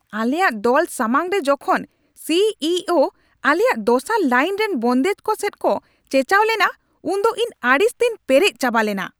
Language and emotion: Santali, angry